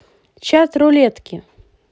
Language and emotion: Russian, positive